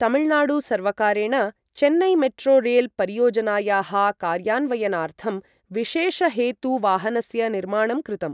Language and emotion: Sanskrit, neutral